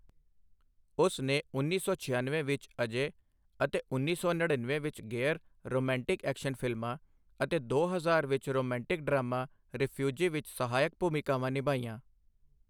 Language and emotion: Punjabi, neutral